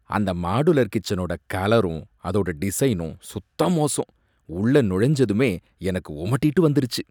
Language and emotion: Tamil, disgusted